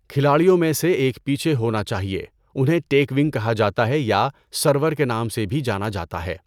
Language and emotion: Urdu, neutral